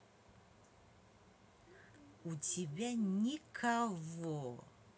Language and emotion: Russian, angry